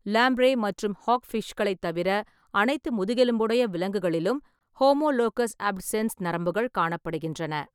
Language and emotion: Tamil, neutral